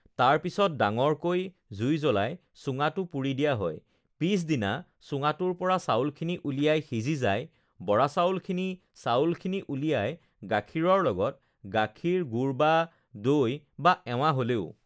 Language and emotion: Assamese, neutral